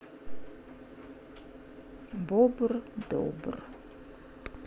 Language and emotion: Russian, neutral